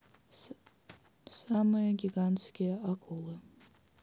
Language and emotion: Russian, neutral